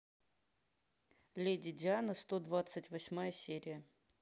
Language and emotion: Russian, neutral